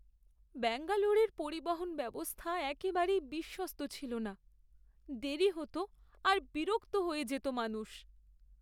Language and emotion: Bengali, sad